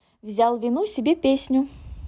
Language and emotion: Russian, positive